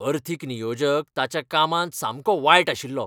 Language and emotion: Goan Konkani, angry